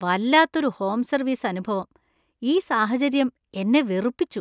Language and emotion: Malayalam, disgusted